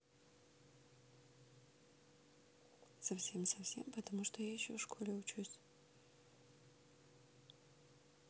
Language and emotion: Russian, neutral